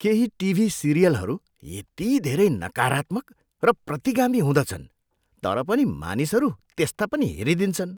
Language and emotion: Nepali, disgusted